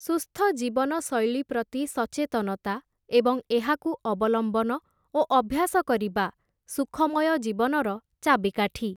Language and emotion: Odia, neutral